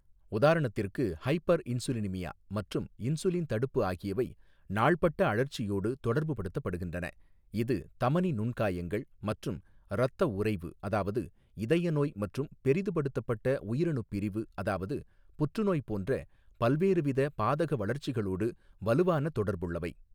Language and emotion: Tamil, neutral